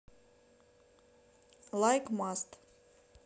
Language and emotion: Russian, neutral